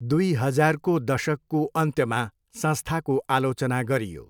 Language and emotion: Nepali, neutral